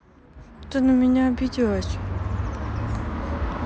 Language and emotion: Russian, sad